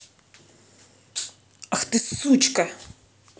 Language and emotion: Russian, angry